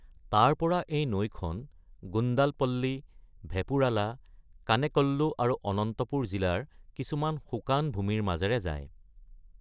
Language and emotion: Assamese, neutral